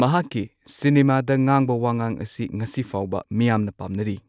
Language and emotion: Manipuri, neutral